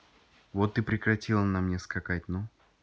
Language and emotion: Russian, neutral